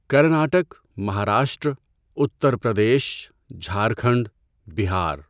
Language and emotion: Urdu, neutral